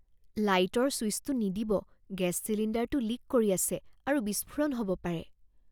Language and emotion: Assamese, fearful